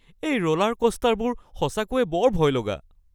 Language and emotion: Assamese, fearful